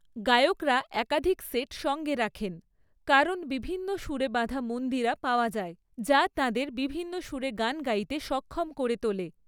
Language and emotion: Bengali, neutral